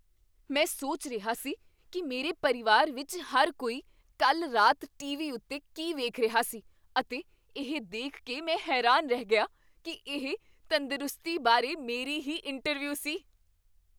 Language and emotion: Punjabi, surprised